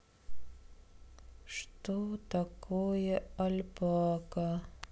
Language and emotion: Russian, sad